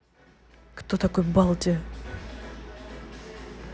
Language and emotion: Russian, neutral